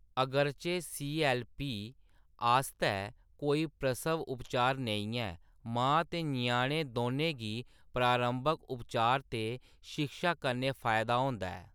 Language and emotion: Dogri, neutral